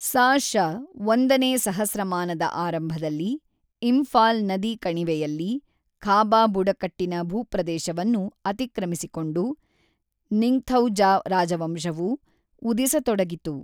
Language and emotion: Kannada, neutral